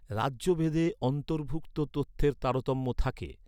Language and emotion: Bengali, neutral